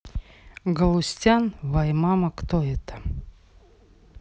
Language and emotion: Russian, neutral